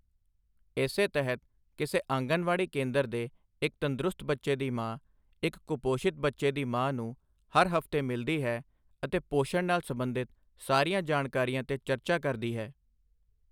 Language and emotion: Punjabi, neutral